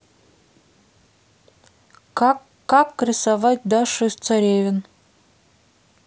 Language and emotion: Russian, neutral